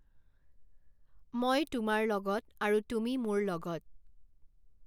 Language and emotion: Assamese, neutral